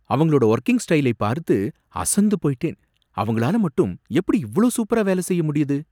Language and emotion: Tamil, surprised